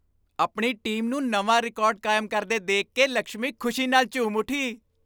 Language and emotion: Punjabi, happy